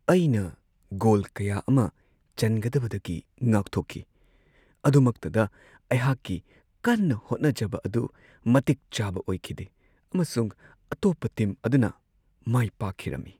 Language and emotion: Manipuri, sad